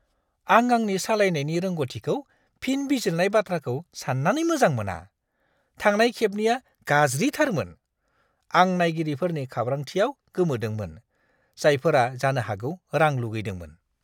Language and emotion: Bodo, disgusted